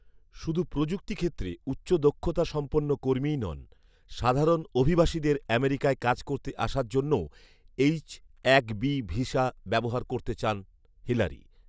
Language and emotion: Bengali, neutral